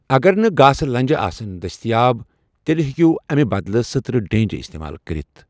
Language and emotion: Kashmiri, neutral